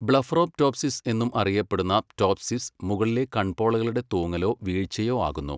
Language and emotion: Malayalam, neutral